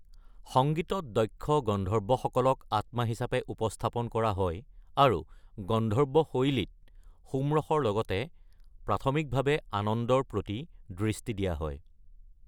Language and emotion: Assamese, neutral